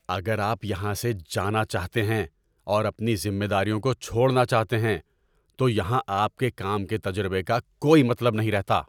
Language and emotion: Urdu, angry